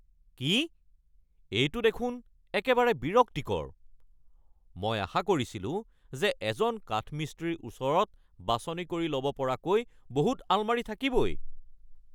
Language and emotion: Assamese, angry